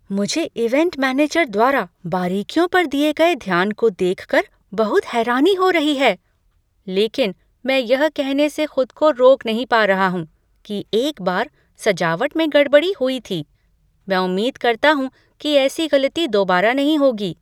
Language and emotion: Hindi, surprised